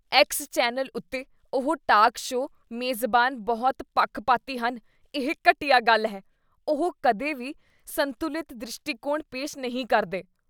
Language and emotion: Punjabi, disgusted